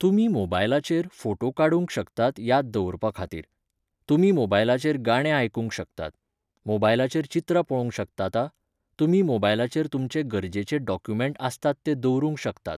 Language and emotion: Goan Konkani, neutral